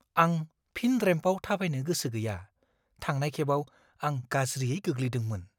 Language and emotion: Bodo, fearful